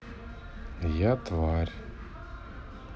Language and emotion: Russian, sad